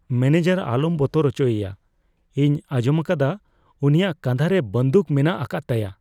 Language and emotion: Santali, fearful